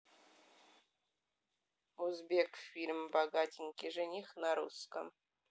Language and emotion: Russian, neutral